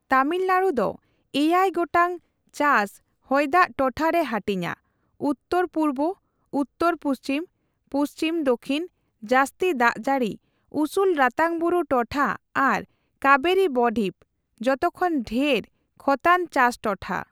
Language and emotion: Santali, neutral